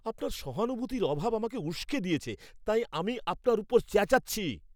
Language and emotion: Bengali, angry